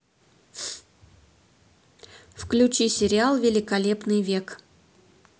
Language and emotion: Russian, neutral